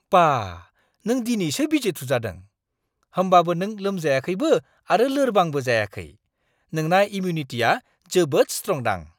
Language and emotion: Bodo, surprised